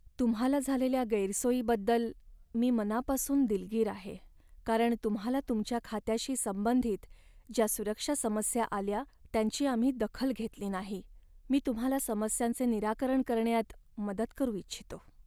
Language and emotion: Marathi, sad